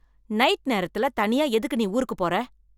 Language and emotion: Tamil, angry